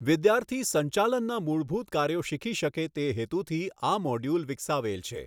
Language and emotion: Gujarati, neutral